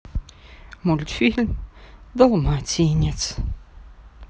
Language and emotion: Russian, sad